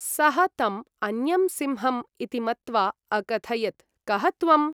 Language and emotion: Sanskrit, neutral